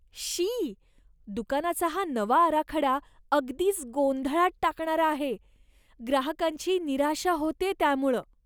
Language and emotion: Marathi, disgusted